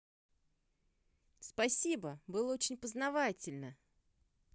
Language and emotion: Russian, positive